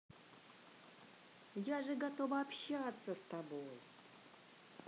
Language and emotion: Russian, positive